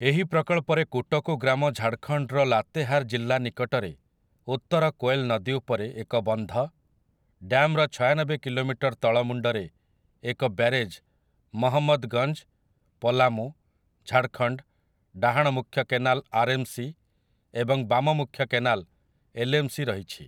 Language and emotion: Odia, neutral